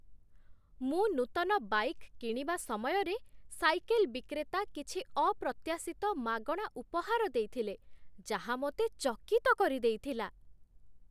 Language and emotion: Odia, surprised